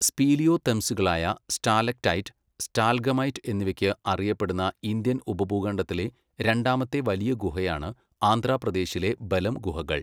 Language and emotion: Malayalam, neutral